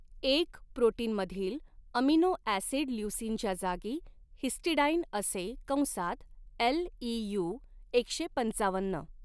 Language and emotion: Marathi, neutral